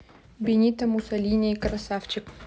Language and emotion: Russian, neutral